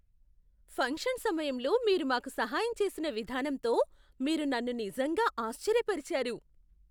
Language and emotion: Telugu, surprised